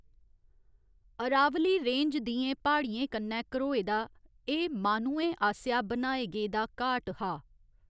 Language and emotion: Dogri, neutral